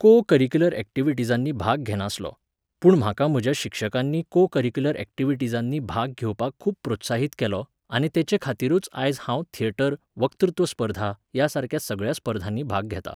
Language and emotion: Goan Konkani, neutral